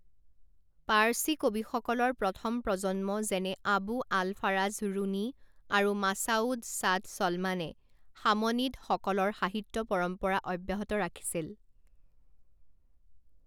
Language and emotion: Assamese, neutral